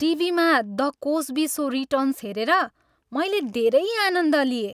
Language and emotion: Nepali, happy